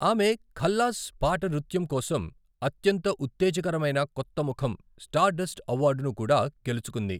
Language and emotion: Telugu, neutral